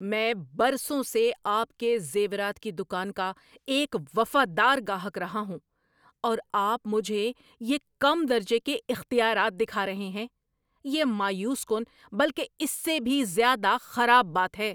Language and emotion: Urdu, angry